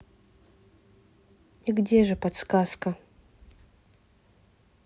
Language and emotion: Russian, neutral